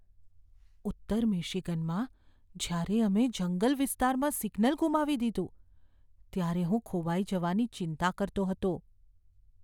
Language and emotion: Gujarati, fearful